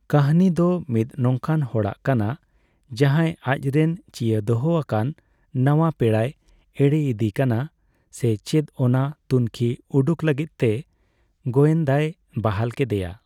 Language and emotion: Santali, neutral